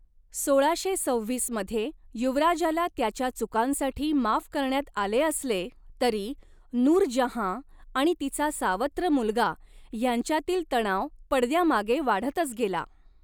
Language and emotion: Marathi, neutral